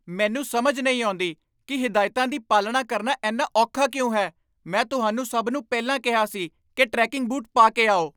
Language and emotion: Punjabi, angry